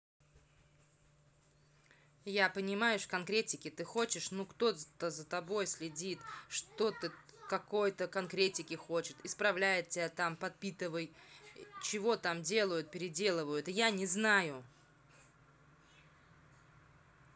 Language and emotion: Russian, angry